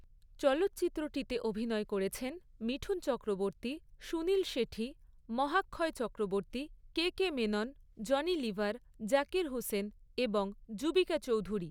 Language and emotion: Bengali, neutral